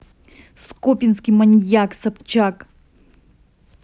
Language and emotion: Russian, angry